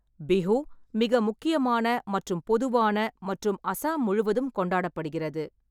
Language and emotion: Tamil, neutral